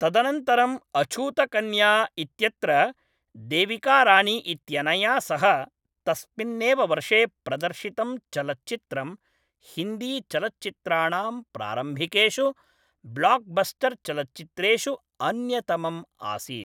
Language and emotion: Sanskrit, neutral